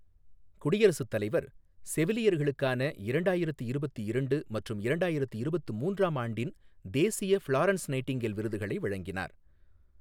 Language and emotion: Tamil, neutral